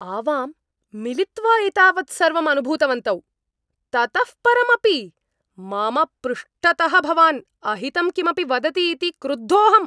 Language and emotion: Sanskrit, angry